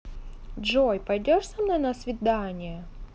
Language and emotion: Russian, positive